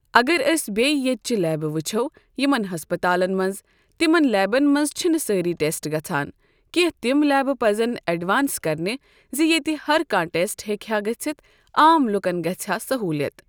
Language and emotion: Kashmiri, neutral